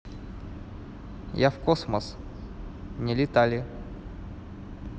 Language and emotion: Russian, neutral